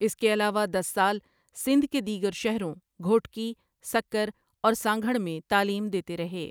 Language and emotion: Urdu, neutral